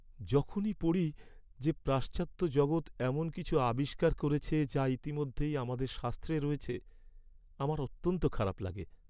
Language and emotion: Bengali, sad